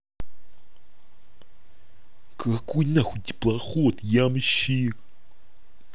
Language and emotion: Russian, angry